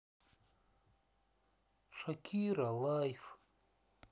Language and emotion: Russian, sad